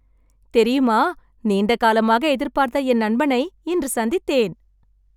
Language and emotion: Tamil, happy